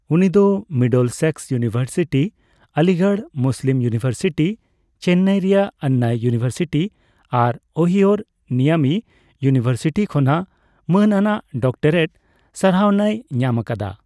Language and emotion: Santali, neutral